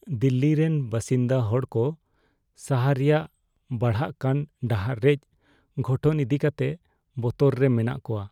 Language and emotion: Santali, fearful